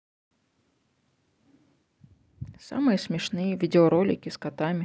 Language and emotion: Russian, neutral